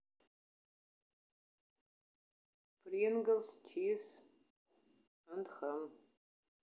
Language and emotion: Russian, sad